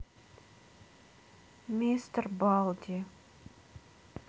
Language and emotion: Russian, sad